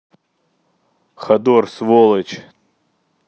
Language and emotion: Russian, angry